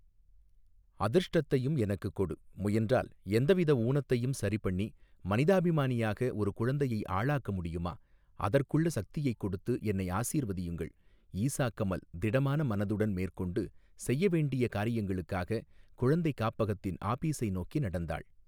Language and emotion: Tamil, neutral